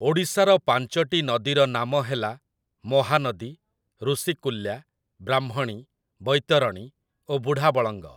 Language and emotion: Odia, neutral